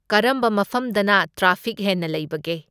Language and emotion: Manipuri, neutral